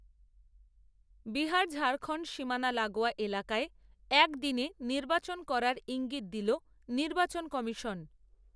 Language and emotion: Bengali, neutral